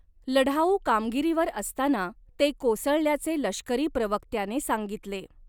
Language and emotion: Marathi, neutral